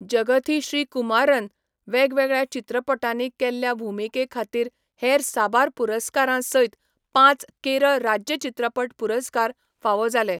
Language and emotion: Goan Konkani, neutral